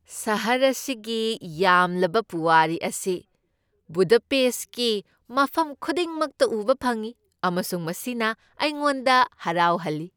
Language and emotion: Manipuri, happy